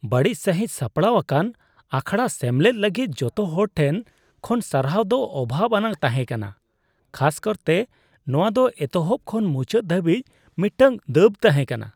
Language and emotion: Santali, disgusted